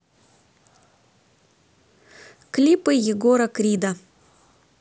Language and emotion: Russian, neutral